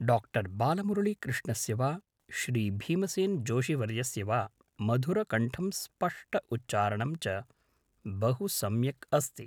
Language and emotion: Sanskrit, neutral